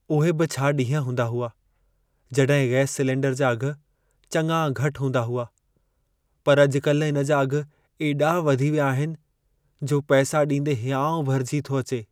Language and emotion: Sindhi, sad